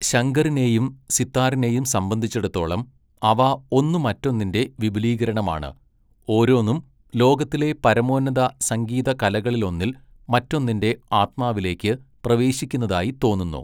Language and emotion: Malayalam, neutral